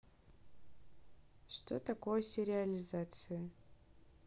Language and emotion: Russian, neutral